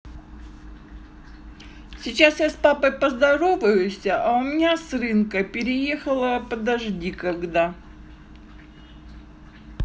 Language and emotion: Russian, neutral